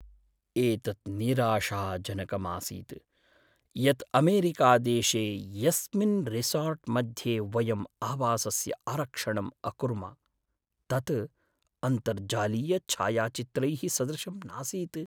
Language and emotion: Sanskrit, sad